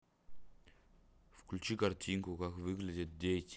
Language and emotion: Russian, neutral